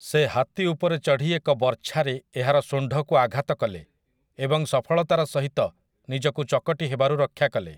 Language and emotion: Odia, neutral